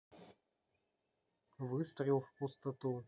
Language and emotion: Russian, neutral